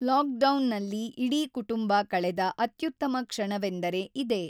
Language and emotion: Kannada, neutral